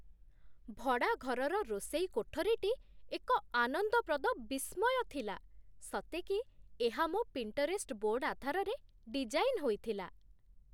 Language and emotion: Odia, surprised